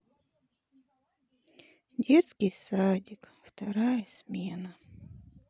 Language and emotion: Russian, sad